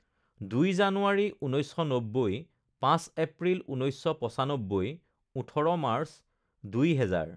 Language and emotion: Assamese, neutral